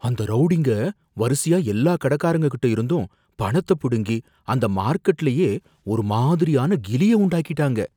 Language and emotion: Tamil, fearful